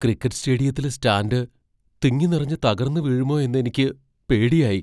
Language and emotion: Malayalam, fearful